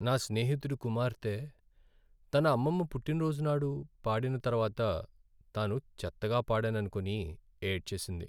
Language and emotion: Telugu, sad